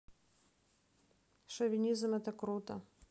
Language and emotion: Russian, neutral